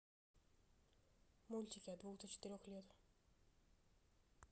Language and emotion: Russian, neutral